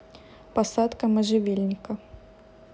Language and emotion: Russian, neutral